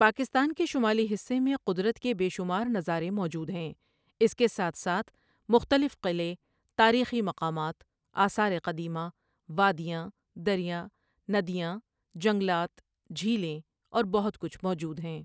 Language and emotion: Urdu, neutral